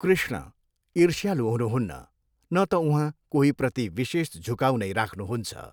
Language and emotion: Nepali, neutral